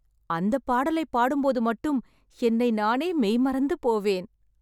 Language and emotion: Tamil, happy